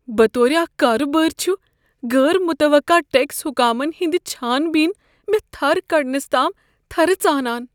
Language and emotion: Kashmiri, fearful